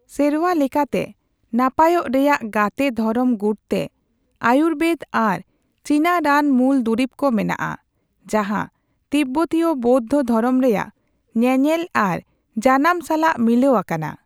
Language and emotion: Santali, neutral